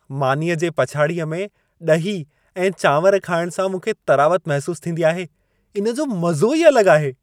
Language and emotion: Sindhi, happy